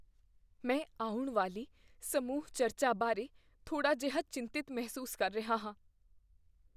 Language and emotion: Punjabi, fearful